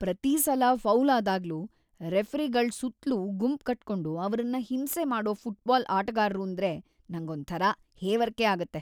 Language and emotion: Kannada, disgusted